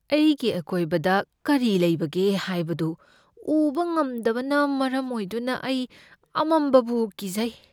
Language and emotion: Manipuri, fearful